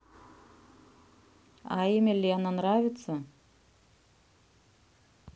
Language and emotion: Russian, neutral